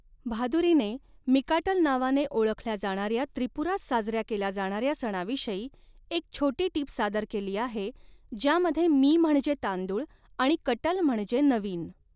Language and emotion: Marathi, neutral